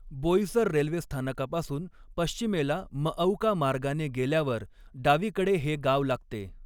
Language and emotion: Marathi, neutral